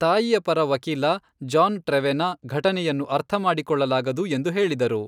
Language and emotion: Kannada, neutral